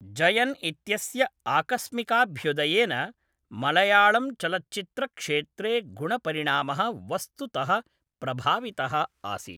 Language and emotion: Sanskrit, neutral